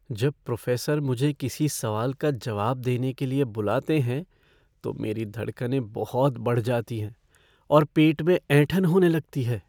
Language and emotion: Hindi, fearful